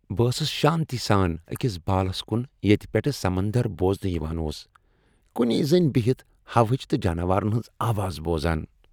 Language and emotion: Kashmiri, happy